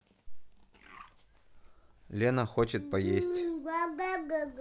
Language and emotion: Russian, neutral